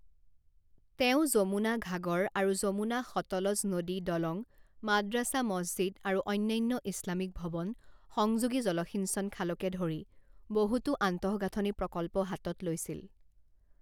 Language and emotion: Assamese, neutral